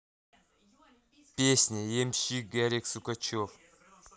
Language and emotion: Russian, neutral